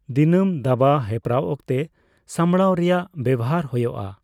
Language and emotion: Santali, neutral